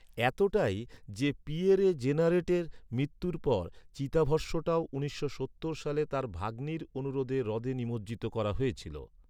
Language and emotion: Bengali, neutral